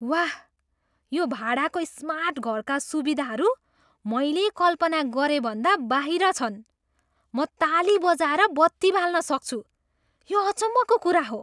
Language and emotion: Nepali, surprised